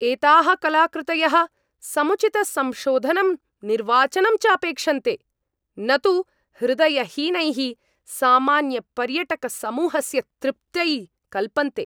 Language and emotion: Sanskrit, angry